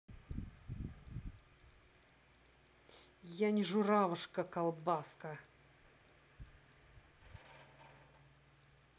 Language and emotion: Russian, angry